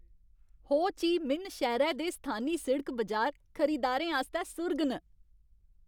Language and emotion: Dogri, happy